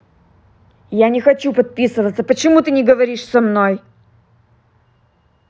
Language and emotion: Russian, angry